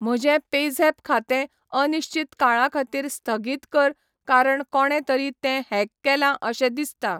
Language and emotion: Goan Konkani, neutral